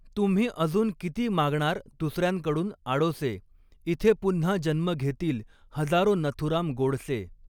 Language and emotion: Marathi, neutral